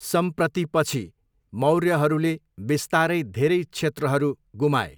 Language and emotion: Nepali, neutral